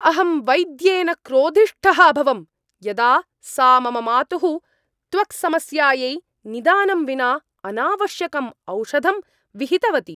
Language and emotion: Sanskrit, angry